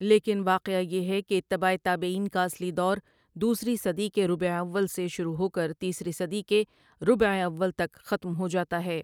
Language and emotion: Urdu, neutral